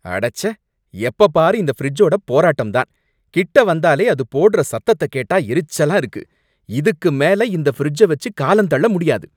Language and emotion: Tamil, angry